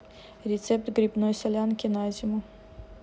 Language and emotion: Russian, neutral